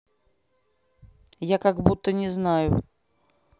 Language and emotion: Russian, angry